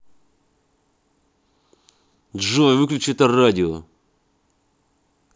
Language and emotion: Russian, angry